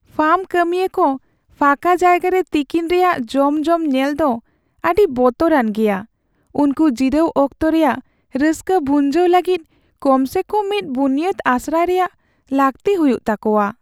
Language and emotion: Santali, sad